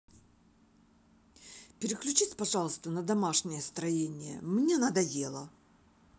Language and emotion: Russian, angry